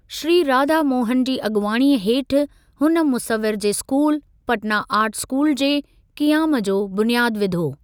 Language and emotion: Sindhi, neutral